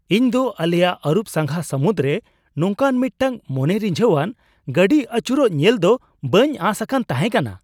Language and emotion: Santali, surprised